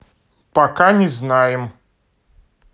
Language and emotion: Russian, neutral